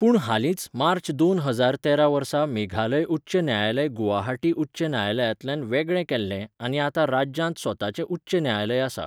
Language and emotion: Goan Konkani, neutral